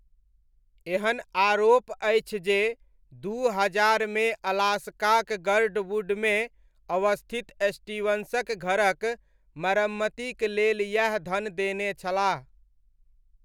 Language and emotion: Maithili, neutral